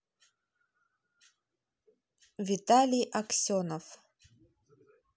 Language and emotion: Russian, neutral